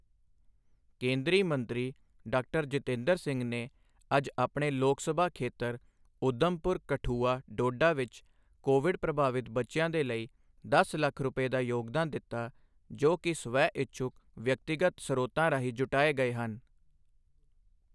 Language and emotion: Punjabi, neutral